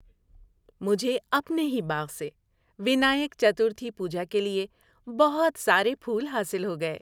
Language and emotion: Urdu, happy